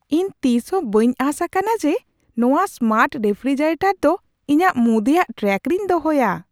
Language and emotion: Santali, surprised